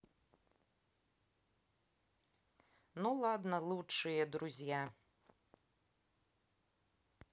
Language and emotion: Russian, neutral